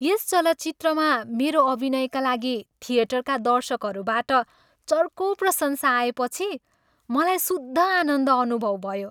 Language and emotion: Nepali, happy